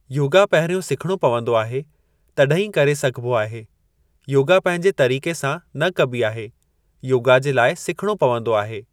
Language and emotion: Sindhi, neutral